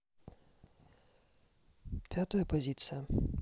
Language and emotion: Russian, neutral